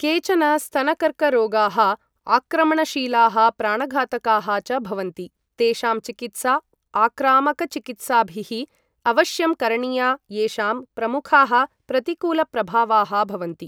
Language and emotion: Sanskrit, neutral